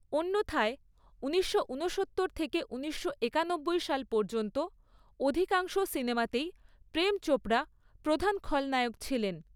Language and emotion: Bengali, neutral